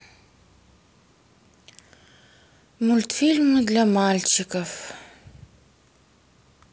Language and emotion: Russian, sad